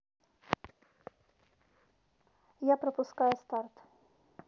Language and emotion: Russian, neutral